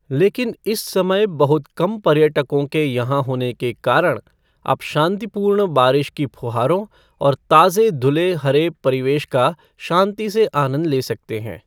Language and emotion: Hindi, neutral